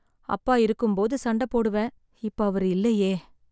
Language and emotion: Tamil, sad